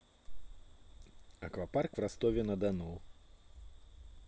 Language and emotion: Russian, neutral